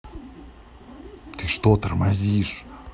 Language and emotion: Russian, angry